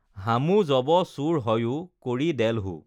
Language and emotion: Assamese, neutral